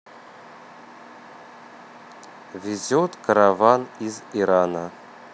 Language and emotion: Russian, neutral